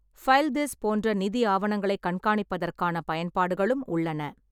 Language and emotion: Tamil, neutral